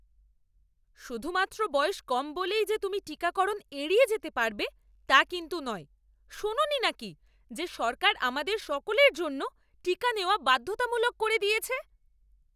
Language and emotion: Bengali, angry